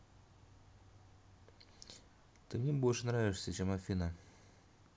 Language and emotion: Russian, neutral